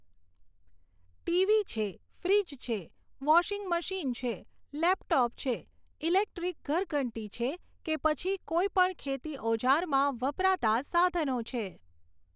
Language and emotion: Gujarati, neutral